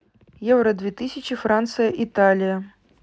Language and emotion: Russian, neutral